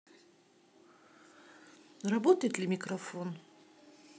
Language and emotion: Russian, neutral